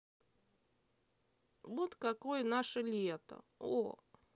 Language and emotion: Russian, neutral